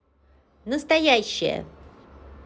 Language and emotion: Russian, positive